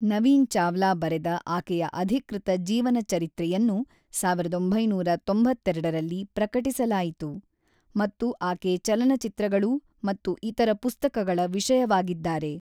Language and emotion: Kannada, neutral